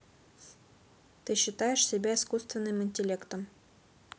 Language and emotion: Russian, neutral